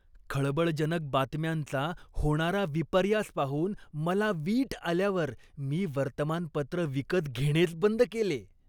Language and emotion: Marathi, disgusted